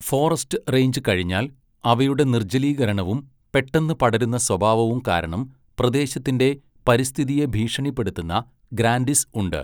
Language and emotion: Malayalam, neutral